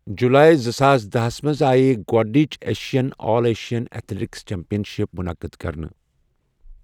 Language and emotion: Kashmiri, neutral